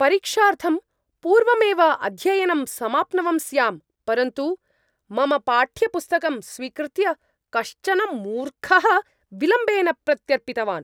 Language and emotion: Sanskrit, angry